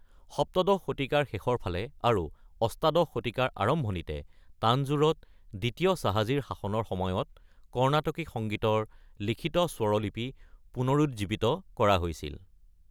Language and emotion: Assamese, neutral